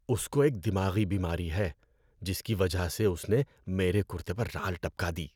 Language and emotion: Urdu, disgusted